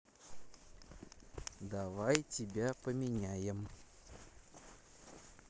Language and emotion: Russian, neutral